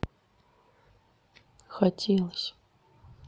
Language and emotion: Russian, sad